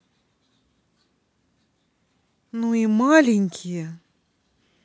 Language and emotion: Russian, neutral